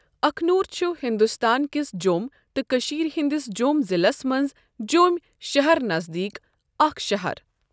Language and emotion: Kashmiri, neutral